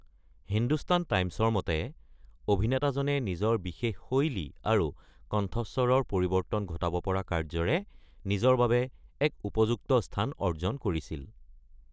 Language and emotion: Assamese, neutral